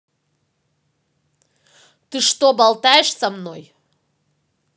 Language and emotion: Russian, angry